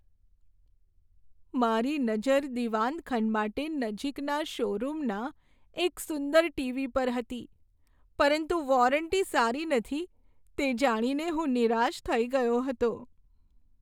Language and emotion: Gujarati, sad